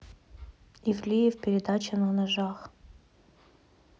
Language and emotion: Russian, neutral